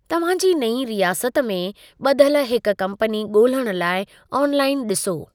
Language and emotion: Sindhi, neutral